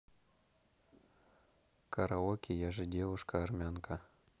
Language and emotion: Russian, neutral